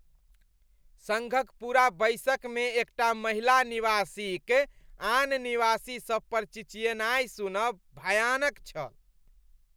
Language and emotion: Maithili, disgusted